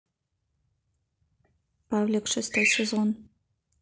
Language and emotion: Russian, neutral